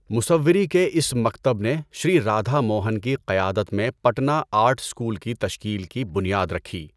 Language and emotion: Urdu, neutral